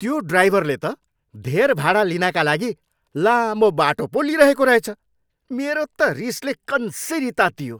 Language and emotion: Nepali, angry